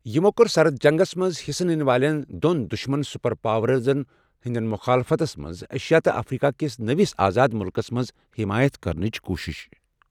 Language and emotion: Kashmiri, neutral